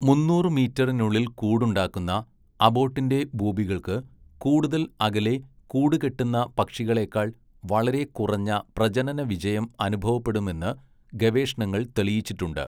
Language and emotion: Malayalam, neutral